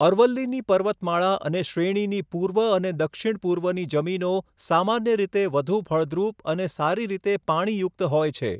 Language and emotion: Gujarati, neutral